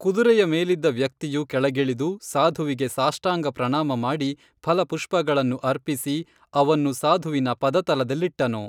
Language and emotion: Kannada, neutral